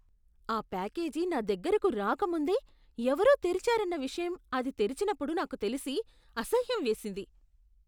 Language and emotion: Telugu, disgusted